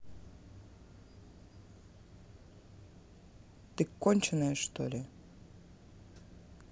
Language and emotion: Russian, angry